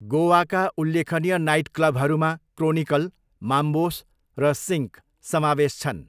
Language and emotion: Nepali, neutral